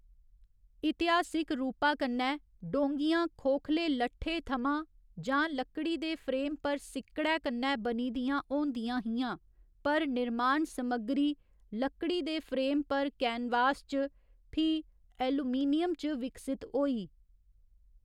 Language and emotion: Dogri, neutral